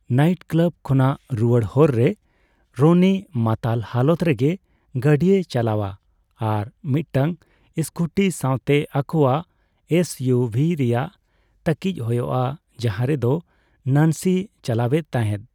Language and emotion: Santali, neutral